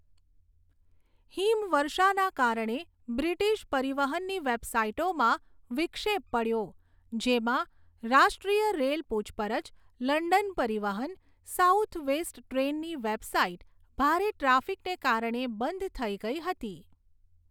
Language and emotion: Gujarati, neutral